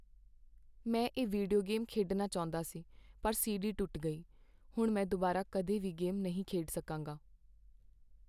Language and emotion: Punjabi, sad